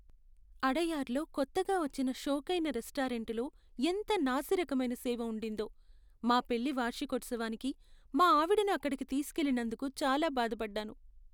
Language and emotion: Telugu, sad